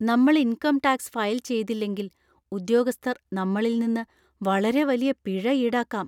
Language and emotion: Malayalam, fearful